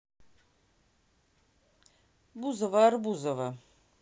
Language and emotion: Russian, neutral